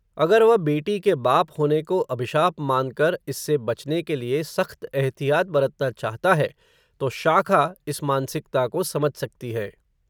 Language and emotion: Hindi, neutral